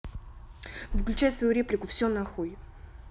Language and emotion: Russian, angry